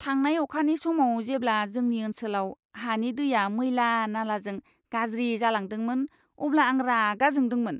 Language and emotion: Bodo, disgusted